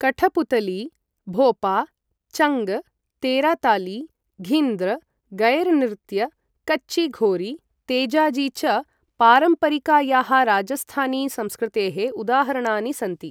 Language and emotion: Sanskrit, neutral